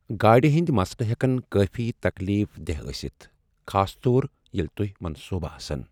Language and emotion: Kashmiri, sad